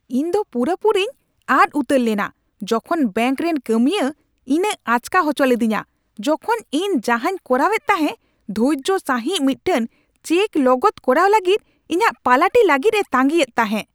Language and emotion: Santali, angry